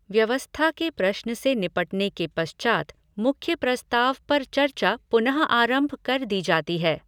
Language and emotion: Hindi, neutral